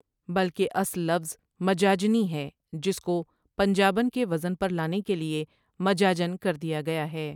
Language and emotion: Urdu, neutral